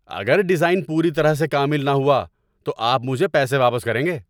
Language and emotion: Urdu, angry